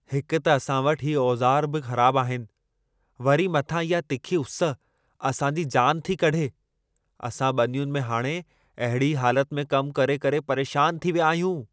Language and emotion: Sindhi, angry